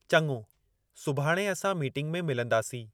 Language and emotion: Sindhi, neutral